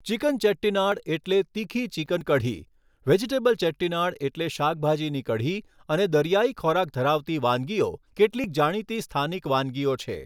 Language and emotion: Gujarati, neutral